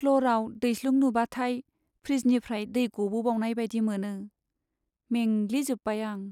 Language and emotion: Bodo, sad